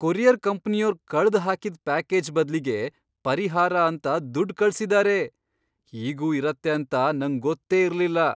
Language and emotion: Kannada, surprised